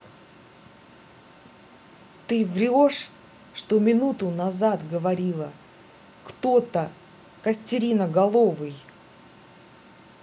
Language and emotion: Russian, angry